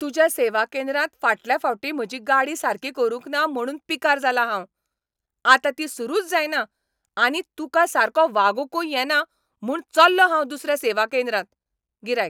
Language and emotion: Goan Konkani, angry